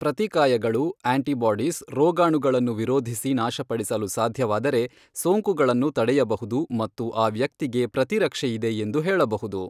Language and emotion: Kannada, neutral